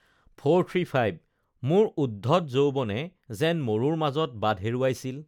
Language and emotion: Assamese, neutral